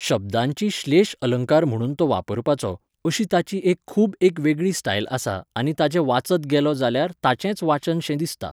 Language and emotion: Goan Konkani, neutral